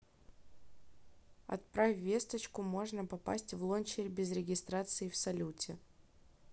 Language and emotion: Russian, neutral